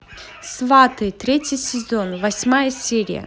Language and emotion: Russian, neutral